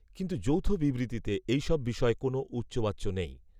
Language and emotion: Bengali, neutral